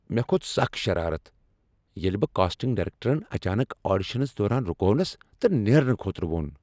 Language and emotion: Kashmiri, angry